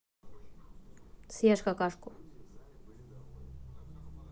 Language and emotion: Russian, neutral